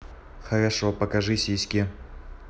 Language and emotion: Russian, neutral